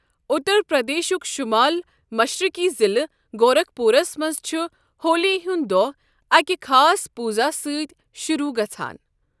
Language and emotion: Kashmiri, neutral